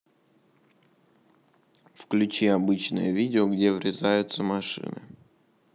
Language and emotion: Russian, neutral